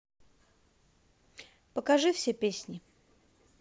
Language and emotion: Russian, positive